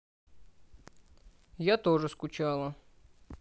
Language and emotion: Russian, sad